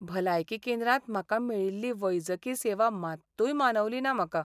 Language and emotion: Goan Konkani, sad